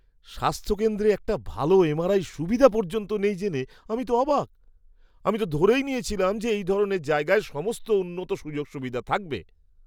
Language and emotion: Bengali, surprised